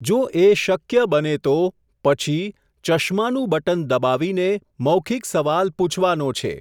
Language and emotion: Gujarati, neutral